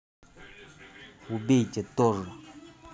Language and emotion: Russian, angry